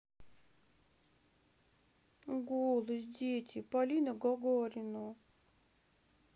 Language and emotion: Russian, sad